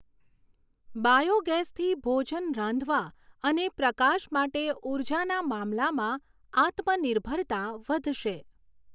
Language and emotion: Gujarati, neutral